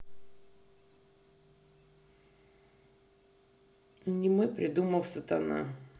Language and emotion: Russian, neutral